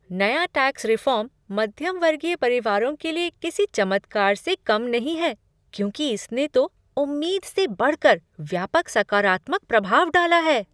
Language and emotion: Hindi, surprised